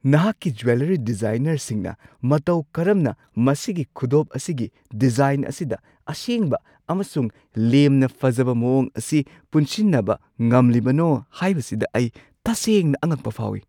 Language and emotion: Manipuri, surprised